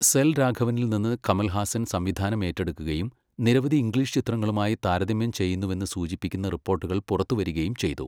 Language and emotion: Malayalam, neutral